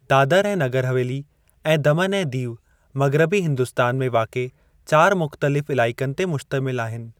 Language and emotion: Sindhi, neutral